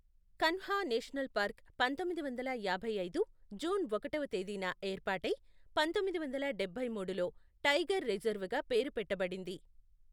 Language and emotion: Telugu, neutral